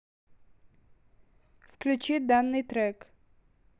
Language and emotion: Russian, neutral